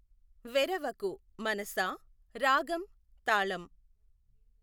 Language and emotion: Telugu, neutral